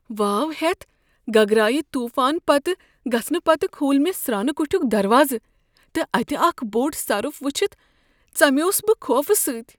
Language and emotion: Kashmiri, fearful